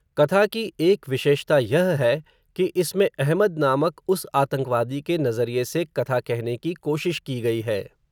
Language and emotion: Hindi, neutral